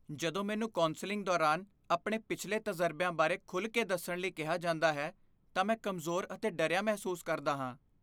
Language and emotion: Punjabi, fearful